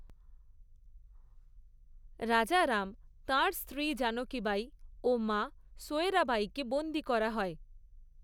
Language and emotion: Bengali, neutral